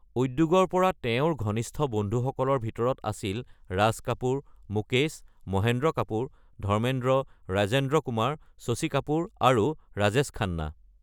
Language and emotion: Assamese, neutral